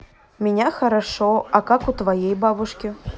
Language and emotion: Russian, neutral